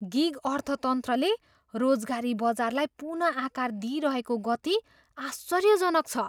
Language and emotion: Nepali, surprised